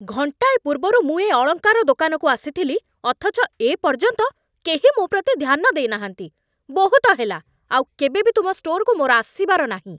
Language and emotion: Odia, angry